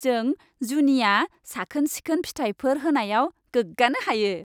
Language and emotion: Bodo, happy